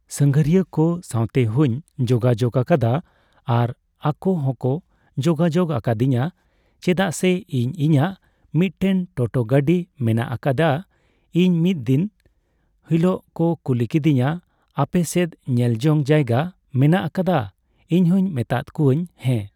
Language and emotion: Santali, neutral